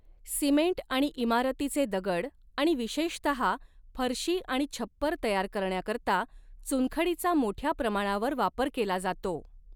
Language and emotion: Marathi, neutral